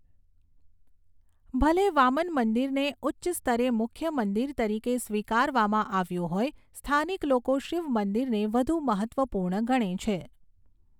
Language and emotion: Gujarati, neutral